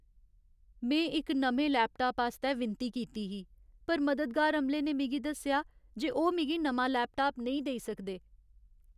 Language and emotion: Dogri, sad